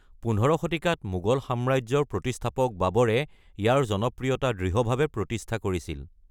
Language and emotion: Assamese, neutral